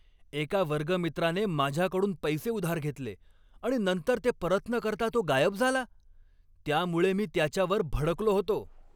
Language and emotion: Marathi, angry